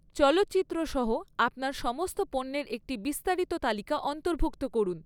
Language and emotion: Bengali, neutral